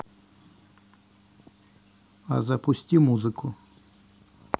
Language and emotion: Russian, neutral